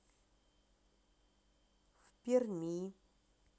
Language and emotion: Russian, neutral